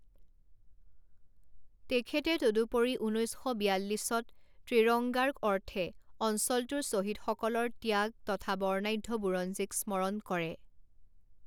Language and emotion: Assamese, neutral